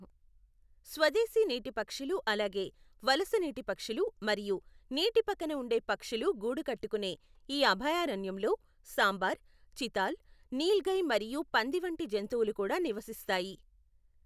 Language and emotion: Telugu, neutral